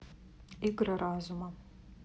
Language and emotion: Russian, neutral